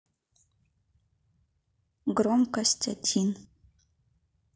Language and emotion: Russian, neutral